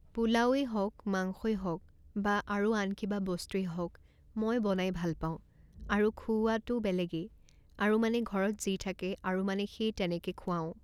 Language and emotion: Assamese, neutral